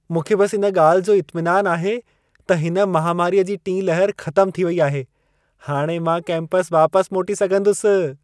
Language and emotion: Sindhi, happy